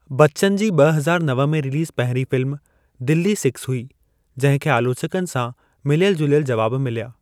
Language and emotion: Sindhi, neutral